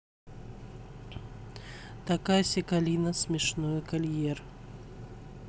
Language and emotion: Russian, neutral